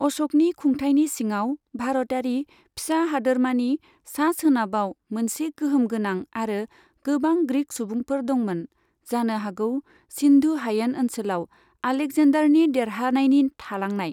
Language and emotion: Bodo, neutral